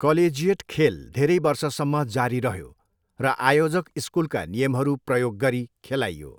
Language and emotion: Nepali, neutral